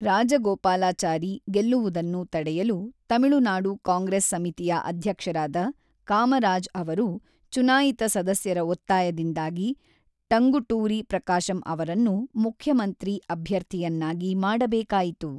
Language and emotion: Kannada, neutral